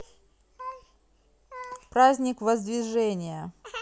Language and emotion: Russian, neutral